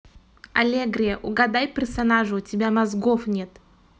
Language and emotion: Russian, angry